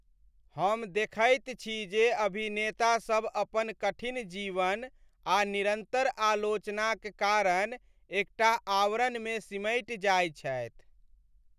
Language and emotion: Maithili, sad